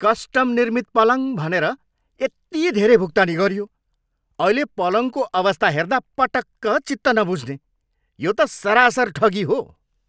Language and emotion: Nepali, angry